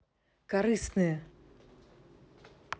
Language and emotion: Russian, neutral